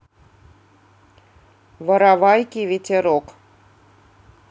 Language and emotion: Russian, neutral